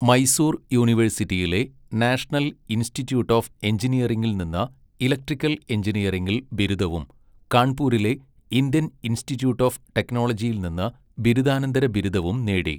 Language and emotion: Malayalam, neutral